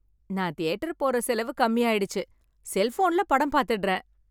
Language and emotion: Tamil, happy